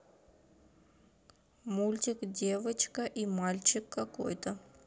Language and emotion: Russian, neutral